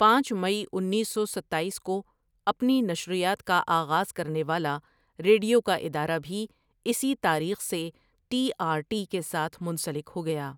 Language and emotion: Urdu, neutral